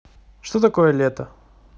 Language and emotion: Russian, neutral